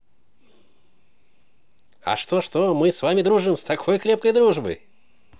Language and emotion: Russian, positive